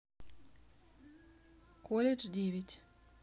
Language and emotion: Russian, neutral